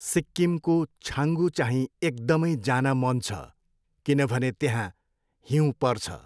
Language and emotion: Nepali, neutral